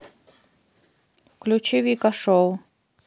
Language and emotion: Russian, neutral